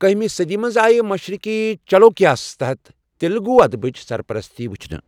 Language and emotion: Kashmiri, neutral